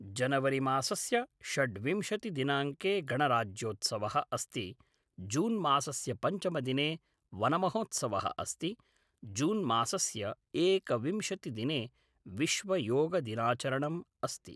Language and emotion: Sanskrit, neutral